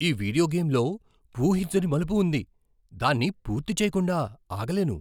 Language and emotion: Telugu, surprised